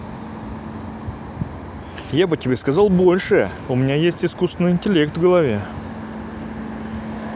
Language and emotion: Russian, neutral